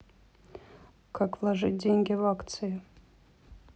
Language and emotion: Russian, neutral